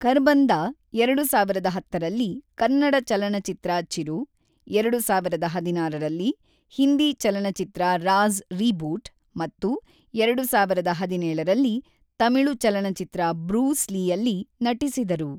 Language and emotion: Kannada, neutral